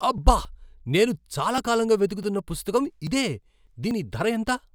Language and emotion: Telugu, surprised